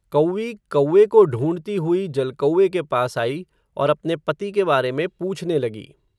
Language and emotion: Hindi, neutral